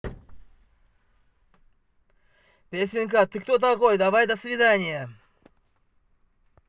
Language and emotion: Russian, angry